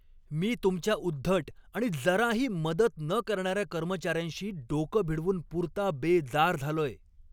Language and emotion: Marathi, angry